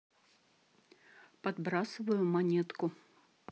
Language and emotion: Russian, neutral